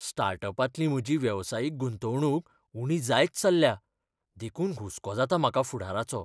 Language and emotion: Goan Konkani, fearful